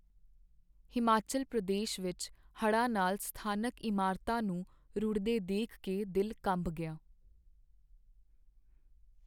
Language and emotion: Punjabi, sad